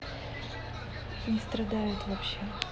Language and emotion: Russian, neutral